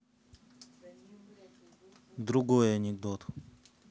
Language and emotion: Russian, neutral